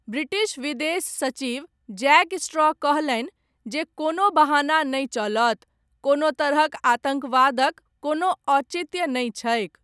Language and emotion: Maithili, neutral